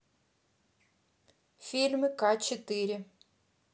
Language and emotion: Russian, neutral